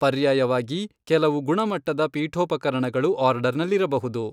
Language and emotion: Kannada, neutral